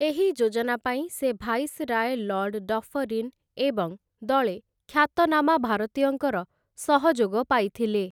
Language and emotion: Odia, neutral